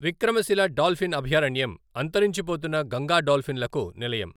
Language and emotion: Telugu, neutral